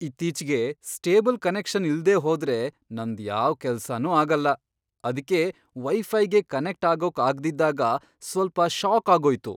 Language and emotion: Kannada, surprised